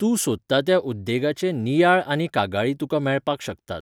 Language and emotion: Goan Konkani, neutral